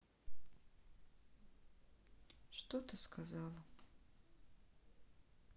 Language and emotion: Russian, sad